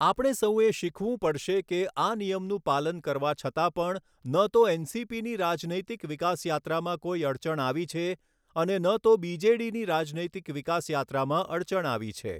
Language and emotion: Gujarati, neutral